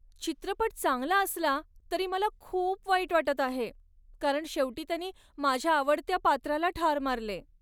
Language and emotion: Marathi, sad